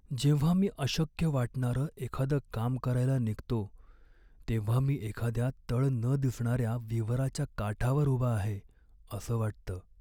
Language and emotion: Marathi, sad